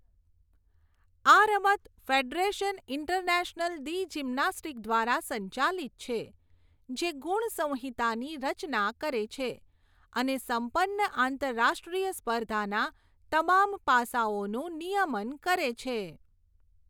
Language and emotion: Gujarati, neutral